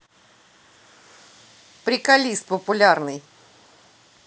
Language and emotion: Russian, positive